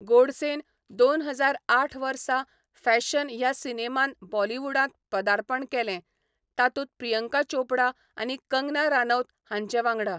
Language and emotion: Goan Konkani, neutral